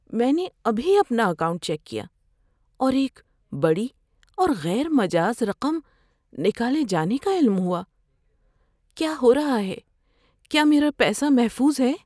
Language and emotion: Urdu, fearful